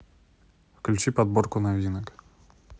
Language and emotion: Russian, neutral